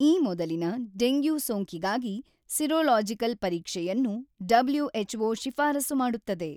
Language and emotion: Kannada, neutral